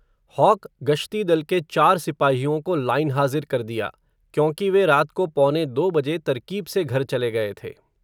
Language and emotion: Hindi, neutral